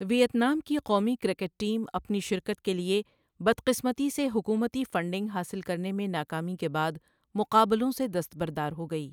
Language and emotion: Urdu, neutral